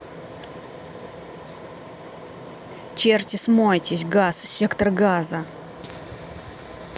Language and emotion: Russian, angry